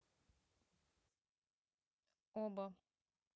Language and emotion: Russian, neutral